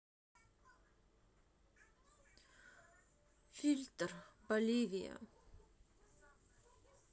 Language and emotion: Russian, sad